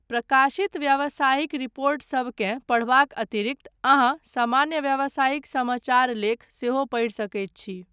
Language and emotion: Maithili, neutral